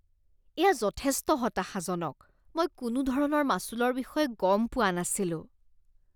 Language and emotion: Assamese, disgusted